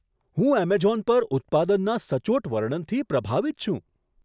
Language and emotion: Gujarati, surprised